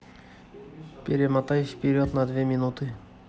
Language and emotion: Russian, neutral